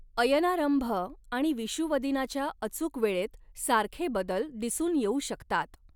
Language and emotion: Marathi, neutral